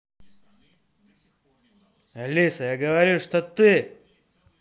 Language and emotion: Russian, angry